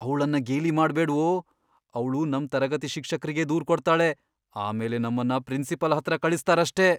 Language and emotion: Kannada, fearful